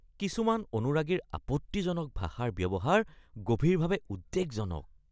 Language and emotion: Assamese, disgusted